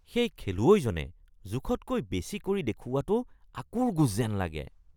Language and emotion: Assamese, disgusted